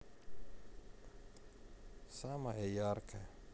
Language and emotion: Russian, sad